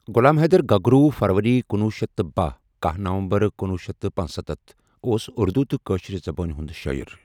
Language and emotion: Kashmiri, neutral